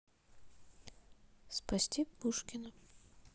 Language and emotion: Russian, neutral